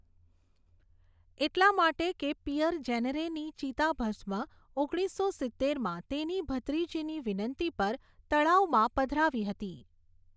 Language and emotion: Gujarati, neutral